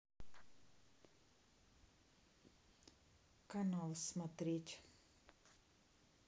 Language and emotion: Russian, neutral